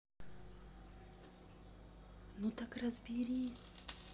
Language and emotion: Russian, neutral